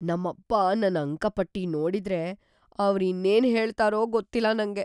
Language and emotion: Kannada, fearful